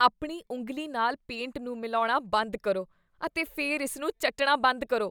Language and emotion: Punjabi, disgusted